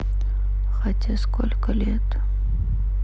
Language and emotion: Russian, sad